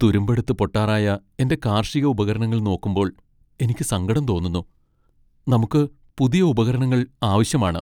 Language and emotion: Malayalam, sad